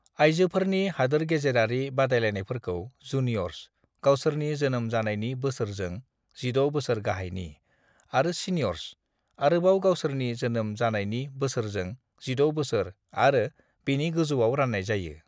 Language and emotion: Bodo, neutral